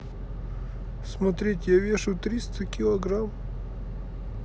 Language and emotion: Russian, sad